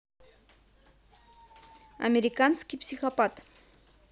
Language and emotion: Russian, neutral